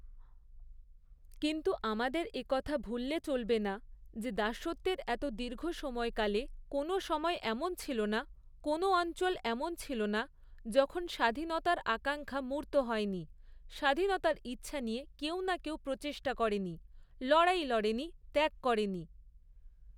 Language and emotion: Bengali, neutral